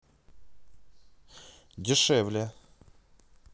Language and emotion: Russian, neutral